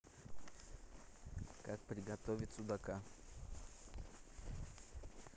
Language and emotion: Russian, neutral